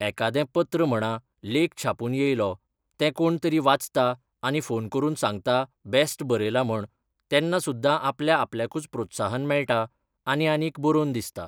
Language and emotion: Goan Konkani, neutral